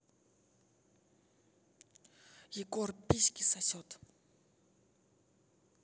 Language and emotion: Russian, angry